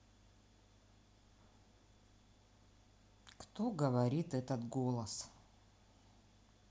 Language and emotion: Russian, neutral